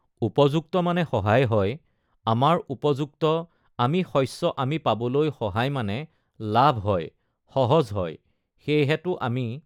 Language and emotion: Assamese, neutral